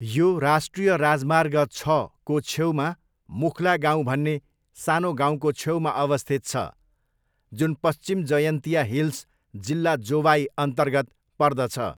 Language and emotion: Nepali, neutral